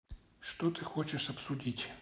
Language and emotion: Russian, neutral